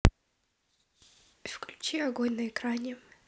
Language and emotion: Russian, neutral